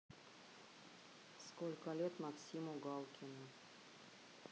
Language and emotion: Russian, neutral